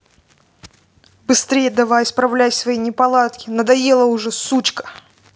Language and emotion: Russian, angry